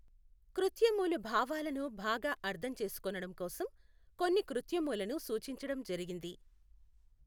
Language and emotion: Telugu, neutral